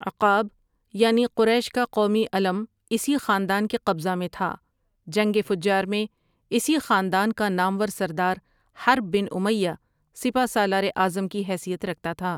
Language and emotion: Urdu, neutral